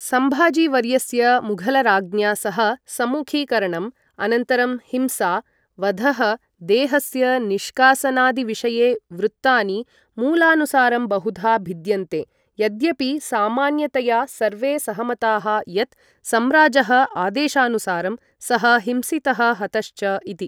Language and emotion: Sanskrit, neutral